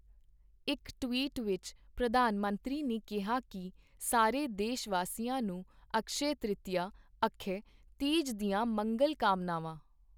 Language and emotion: Punjabi, neutral